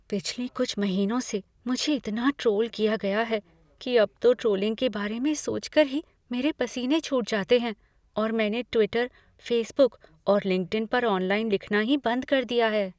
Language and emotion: Hindi, fearful